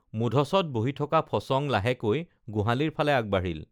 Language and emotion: Assamese, neutral